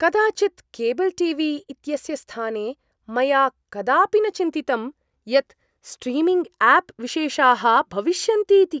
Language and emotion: Sanskrit, surprised